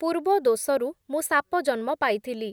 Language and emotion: Odia, neutral